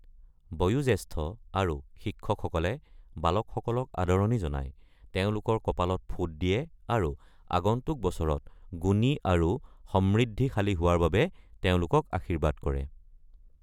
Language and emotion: Assamese, neutral